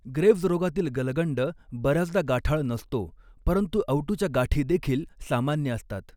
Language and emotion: Marathi, neutral